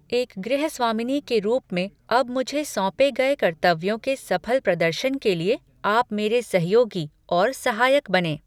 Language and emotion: Hindi, neutral